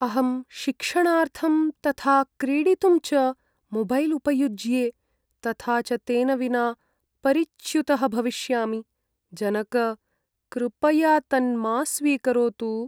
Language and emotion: Sanskrit, sad